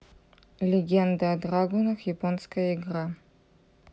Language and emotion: Russian, neutral